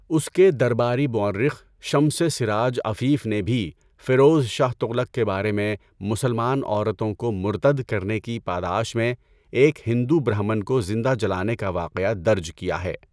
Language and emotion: Urdu, neutral